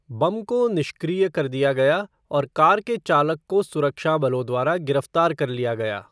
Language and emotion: Hindi, neutral